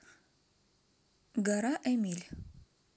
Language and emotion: Russian, neutral